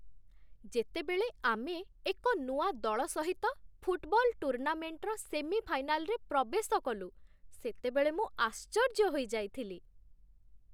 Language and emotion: Odia, surprised